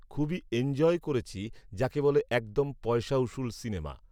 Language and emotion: Bengali, neutral